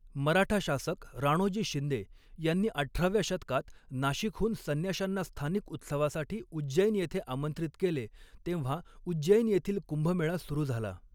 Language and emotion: Marathi, neutral